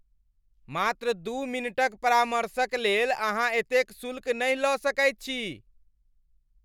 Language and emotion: Maithili, angry